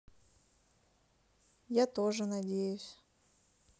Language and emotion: Russian, sad